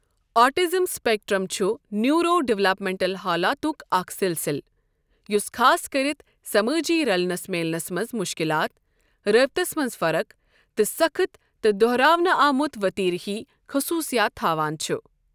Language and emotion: Kashmiri, neutral